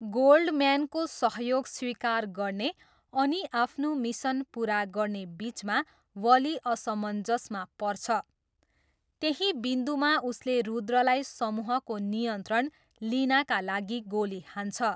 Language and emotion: Nepali, neutral